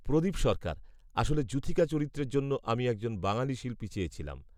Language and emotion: Bengali, neutral